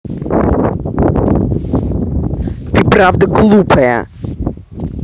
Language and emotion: Russian, angry